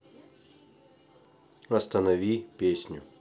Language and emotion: Russian, neutral